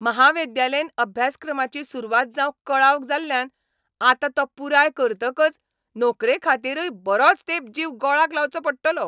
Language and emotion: Goan Konkani, angry